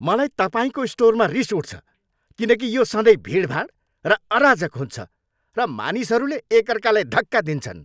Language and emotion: Nepali, angry